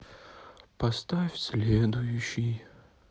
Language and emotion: Russian, sad